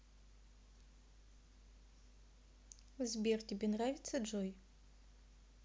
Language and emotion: Russian, neutral